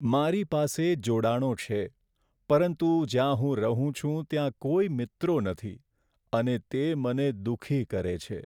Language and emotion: Gujarati, sad